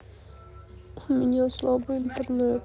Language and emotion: Russian, sad